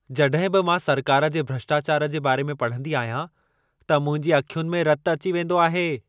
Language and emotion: Sindhi, angry